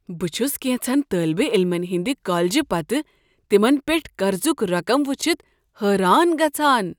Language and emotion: Kashmiri, surprised